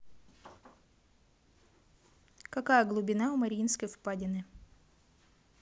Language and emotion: Russian, neutral